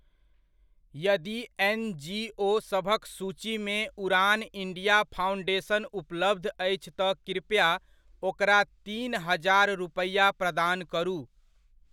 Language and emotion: Maithili, neutral